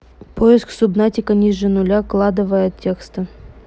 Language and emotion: Russian, neutral